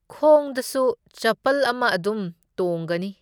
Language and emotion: Manipuri, neutral